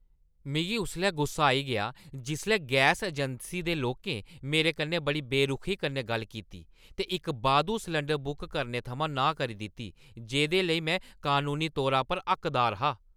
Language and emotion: Dogri, angry